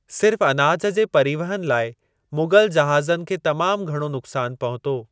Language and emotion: Sindhi, neutral